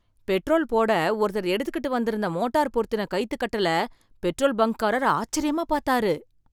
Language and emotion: Tamil, surprised